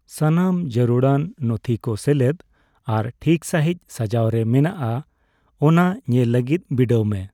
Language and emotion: Santali, neutral